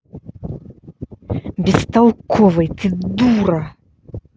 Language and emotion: Russian, angry